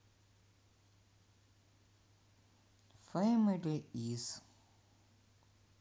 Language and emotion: Russian, neutral